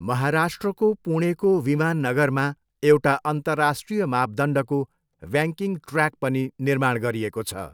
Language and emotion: Nepali, neutral